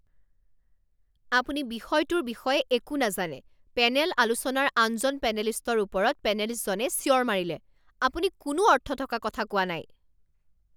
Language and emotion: Assamese, angry